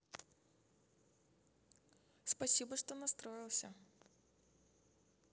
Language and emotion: Russian, positive